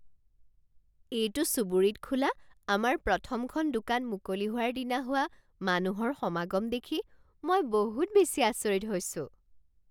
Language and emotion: Assamese, surprised